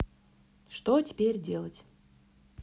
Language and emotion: Russian, neutral